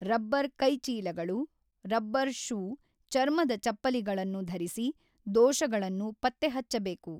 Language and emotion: Kannada, neutral